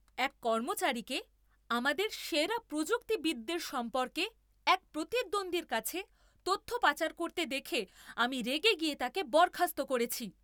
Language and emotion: Bengali, angry